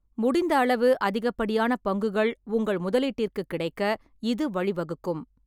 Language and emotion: Tamil, neutral